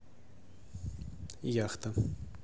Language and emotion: Russian, neutral